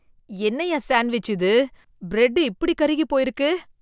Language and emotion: Tamil, disgusted